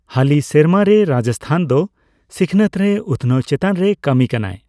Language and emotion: Santali, neutral